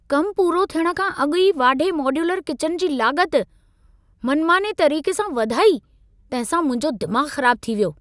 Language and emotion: Sindhi, angry